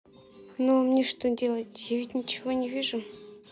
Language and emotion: Russian, sad